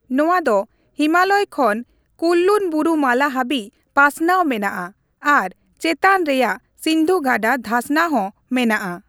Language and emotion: Santali, neutral